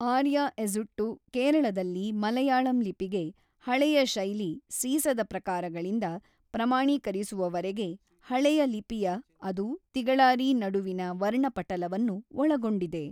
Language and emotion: Kannada, neutral